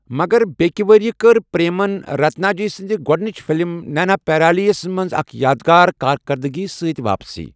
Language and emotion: Kashmiri, neutral